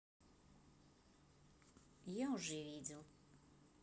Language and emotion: Russian, neutral